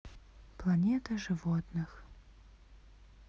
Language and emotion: Russian, neutral